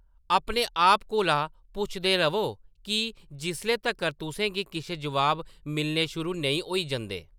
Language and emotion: Dogri, neutral